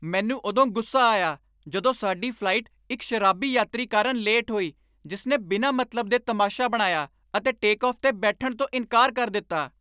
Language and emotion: Punjabi, angry